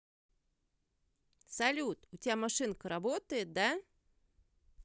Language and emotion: Russian, positive